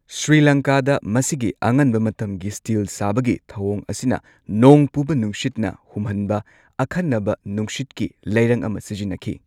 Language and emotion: Manipuri, neutral